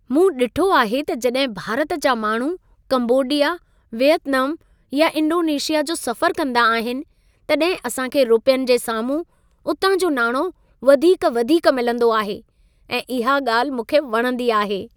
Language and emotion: Sindhi, happy